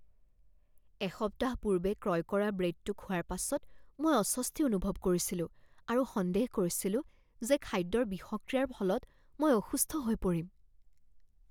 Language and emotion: Assamese, fearful